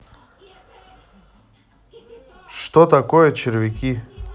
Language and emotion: Russian, neutral